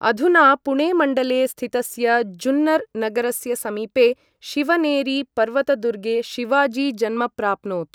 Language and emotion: Sanskrit, neutral